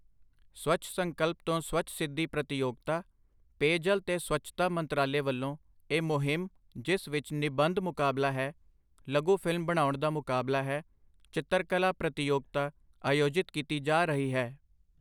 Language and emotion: Punjabi, neutral